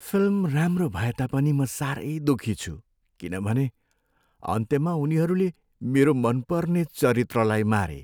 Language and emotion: Nepali, sad